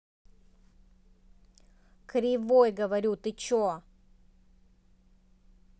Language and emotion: Russian, angry